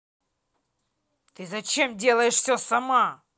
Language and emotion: Russian, angry